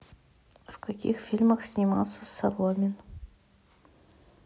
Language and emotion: Russian, neutral